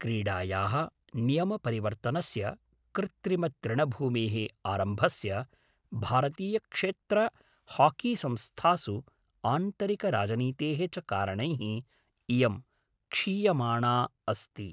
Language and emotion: Sanskrit, neutral